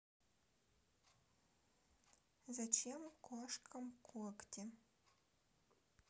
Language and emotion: Russian, neutral